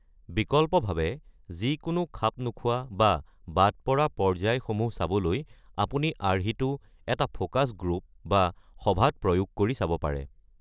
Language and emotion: Assamese, neutral